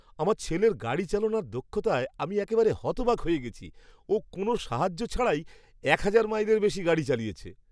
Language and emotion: Bengali, surprised